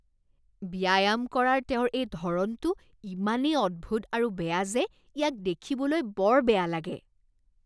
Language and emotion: Assamese, disgusted